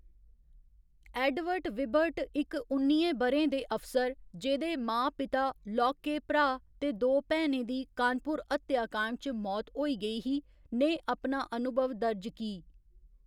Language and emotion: Dogri, neutral